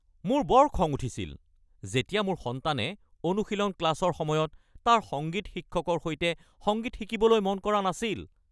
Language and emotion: Assamese, angry